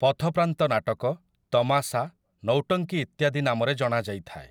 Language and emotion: Odia, neutral